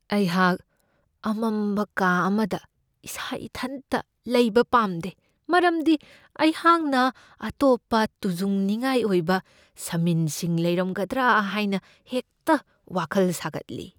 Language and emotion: Manipuri, fearful